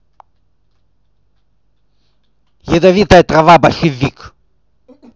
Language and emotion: Russian, angry